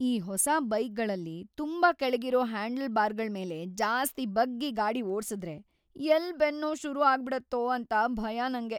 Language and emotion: Kannada, fearful